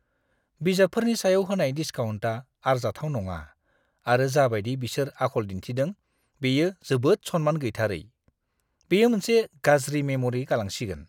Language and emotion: Bodo, disgusted